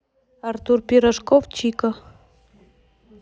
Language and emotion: Russian, neutral